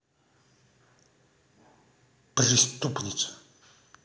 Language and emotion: Russian, angry